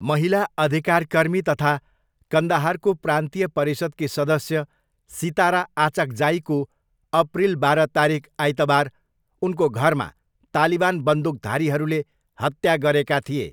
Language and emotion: Nepali, neutral